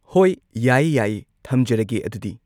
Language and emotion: Manipuri, neutral